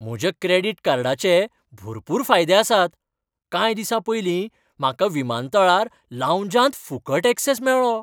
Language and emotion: Goan Konkani, happy